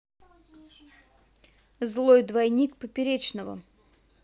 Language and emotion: Russian, neutral